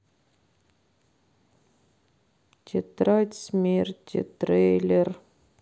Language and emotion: Russian, sad